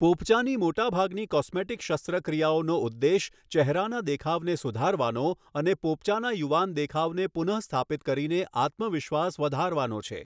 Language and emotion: Gujarati, neutral